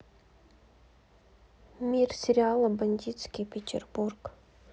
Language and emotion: Russian, sad